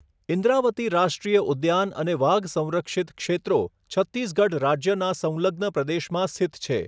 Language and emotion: Gujarati, neutral